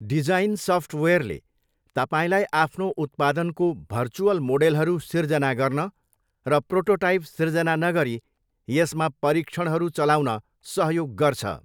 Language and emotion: Nepali, neutral